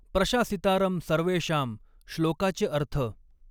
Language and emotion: Marathi, neutral